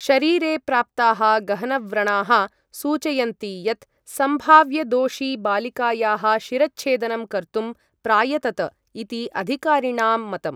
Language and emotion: Sanskrit, neutral